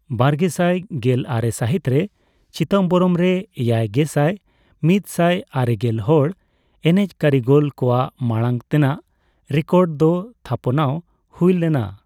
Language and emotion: Santali, neutral